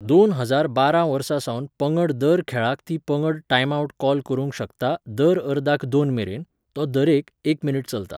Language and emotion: Goan Konkani, neutral